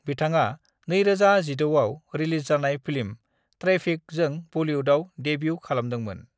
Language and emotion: Bodo, neutral